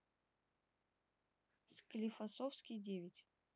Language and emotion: Russian, neutral